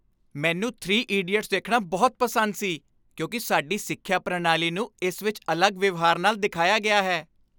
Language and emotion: Punjabi, happy